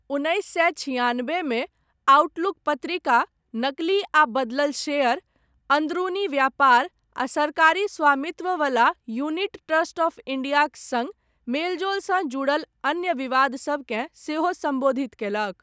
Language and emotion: Maithili, neutral